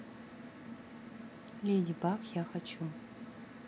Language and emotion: Russian, neutral